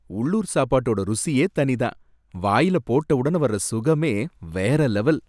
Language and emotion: Tamil, happy